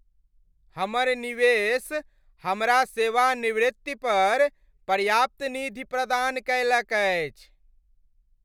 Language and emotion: Maithili, happy